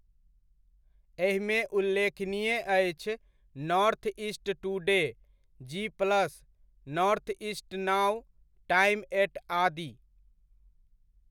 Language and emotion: Maithili, neutral